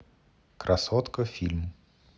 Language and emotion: Russian, neutral